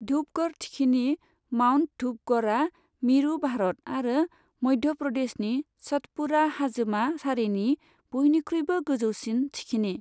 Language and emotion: Bodo, neutral